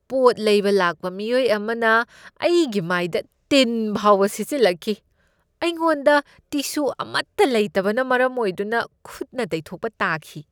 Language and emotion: Manipuri, disgusted